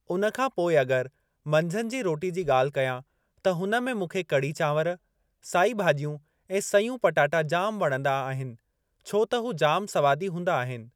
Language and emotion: Sindhi, neutral